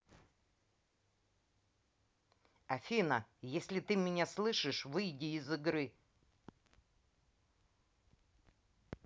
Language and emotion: Russian, angry